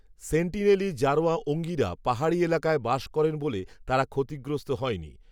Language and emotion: Bengali, neutral